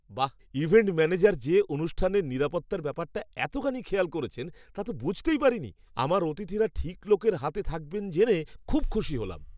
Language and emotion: Bengali, surprised